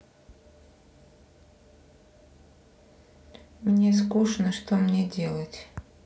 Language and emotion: Russian, sad